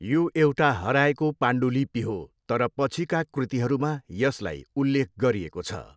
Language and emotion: Nepali, neutral